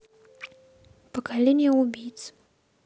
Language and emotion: Russian, neutral